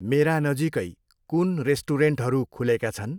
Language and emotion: Nepali, neutral